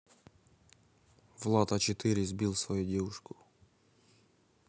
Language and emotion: Russian, neutral